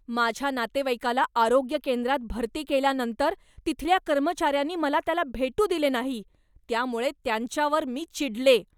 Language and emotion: Marathi, angry